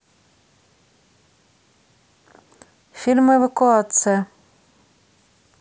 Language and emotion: Russian, neutral